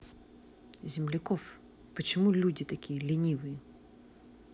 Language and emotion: Russian, angry